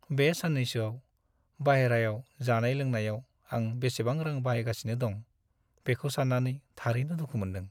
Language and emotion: Bodo, sad